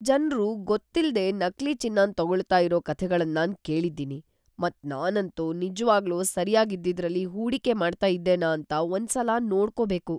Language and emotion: Kannada, fearful